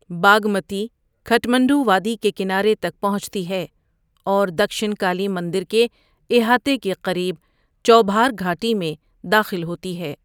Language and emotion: Urdu, neutral